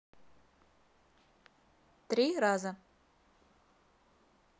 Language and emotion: Russian, neutral